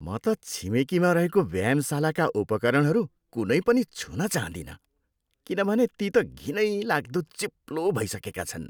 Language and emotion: Nepali, disgusted